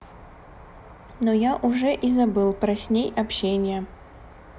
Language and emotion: Russian, neutral